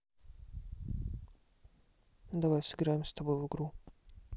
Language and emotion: Russian, neutral